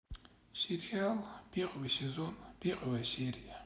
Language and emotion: Russian, sad